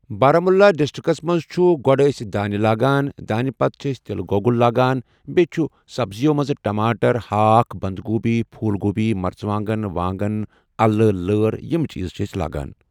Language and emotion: Kashmiri, neutral